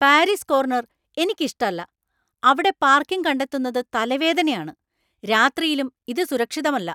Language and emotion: Malayalam, angry